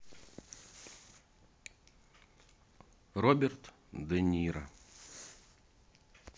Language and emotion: Russian, neutral